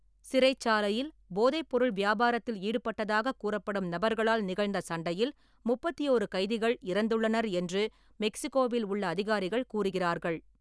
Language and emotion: Tamil, neutral